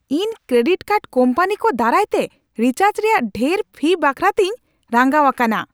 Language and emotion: Santali, angry